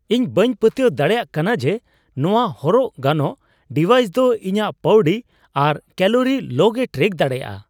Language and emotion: Santali, surprised